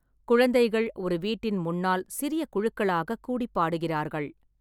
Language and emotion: Tamil, neutral